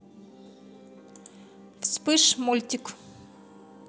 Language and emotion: Russian, positive